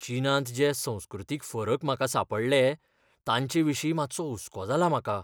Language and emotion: Goan Konkani, fearful